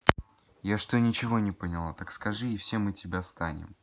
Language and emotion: Russian, neutral